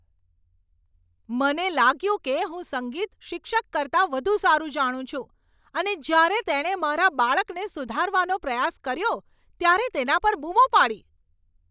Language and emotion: Gujarati, angry